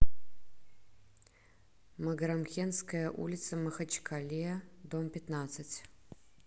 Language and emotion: Russian, neutral